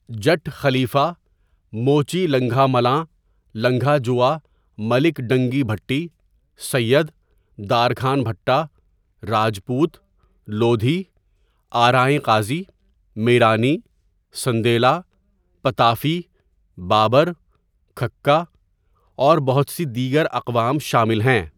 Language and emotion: Urdu, neutral